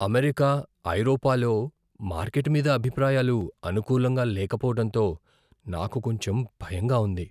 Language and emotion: Telugu, fearful